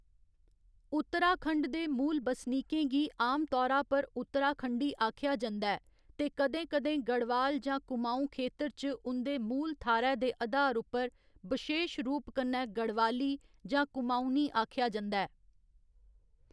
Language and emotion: Dogri, neutral